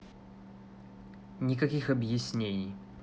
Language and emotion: Russian, angry